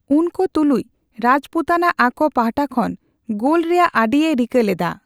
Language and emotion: Santali, neutral